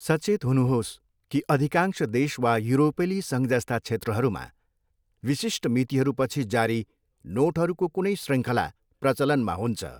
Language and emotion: Nepali, neutral